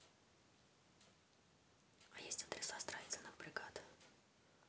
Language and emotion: Russian, neutral